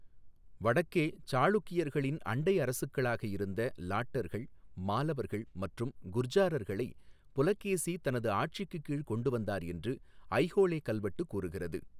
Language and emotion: Tamil, neutral